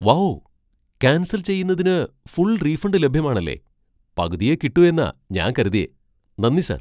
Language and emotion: Malayalam, surprised